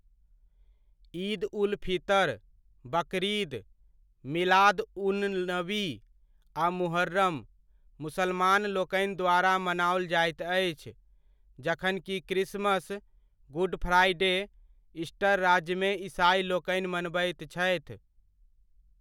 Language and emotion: Maithili, neutral